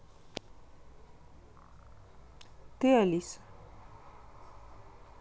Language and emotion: Russian, neutral